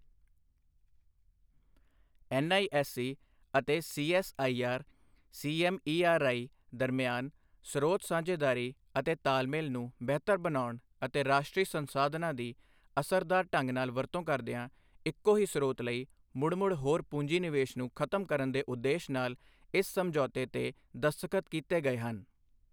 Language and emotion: Punjabi, neutral